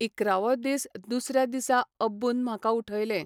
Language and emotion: Goan Konkani, neutral